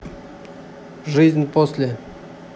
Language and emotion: Russian, neutral